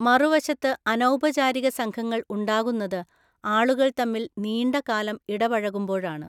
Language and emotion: Malayalam, neutral